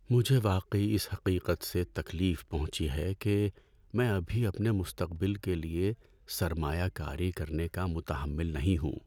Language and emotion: Urdu, sad